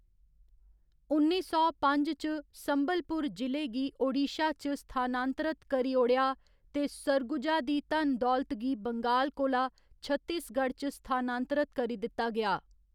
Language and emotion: Dogri, neutral